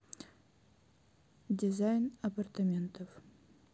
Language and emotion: Russian, neutral